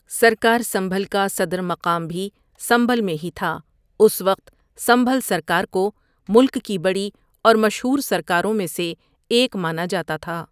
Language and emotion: Urdu, neutral